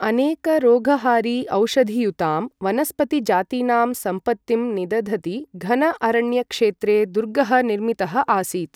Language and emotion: Sanskrit, neutral